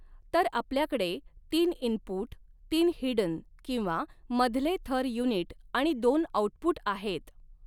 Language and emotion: Marathi, neutral